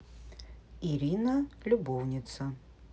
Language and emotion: Russian, neutral